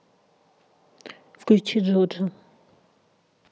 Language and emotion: Russian, neutral